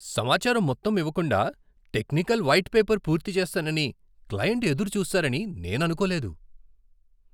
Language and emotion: Telugu, surprised